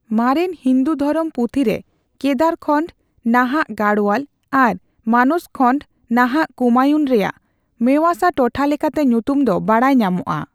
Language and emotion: Santali, neutral